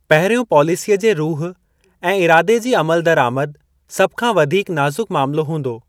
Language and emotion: Sindhi, neutral